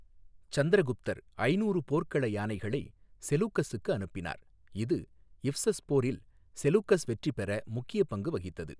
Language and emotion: Tamil, neutral